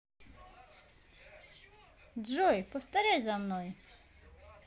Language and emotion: Russian, positive